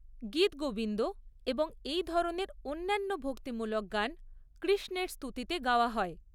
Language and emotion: Bengali, neutral